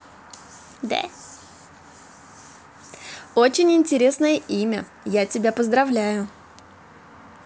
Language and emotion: Russian, positive